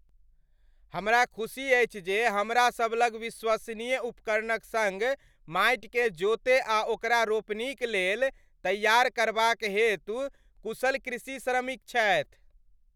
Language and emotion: Maithili, happy